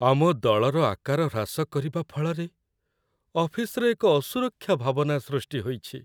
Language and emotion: Odia, sad